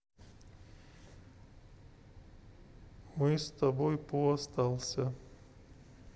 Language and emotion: Russian, sad